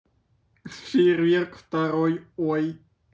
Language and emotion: Russian, positive